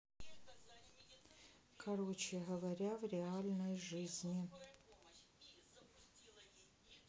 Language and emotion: Russian, sad